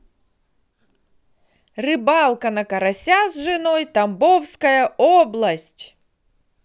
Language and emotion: Russian, positive